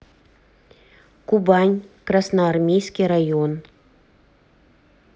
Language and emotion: Russian, neutral